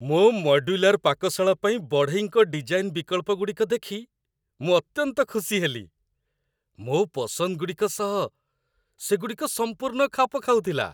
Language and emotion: Odia, happy